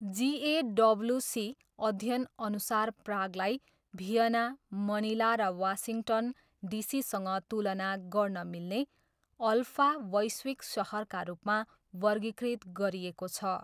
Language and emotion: Nepali, neutral